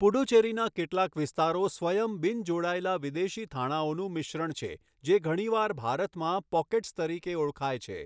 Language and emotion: Gujarati, neutral